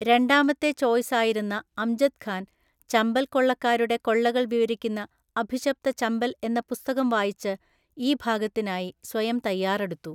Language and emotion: Malayalam, neutral